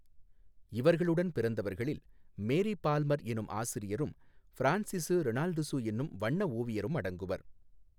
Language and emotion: Tamil, neutral